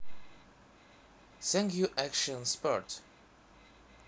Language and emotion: Russian, neutral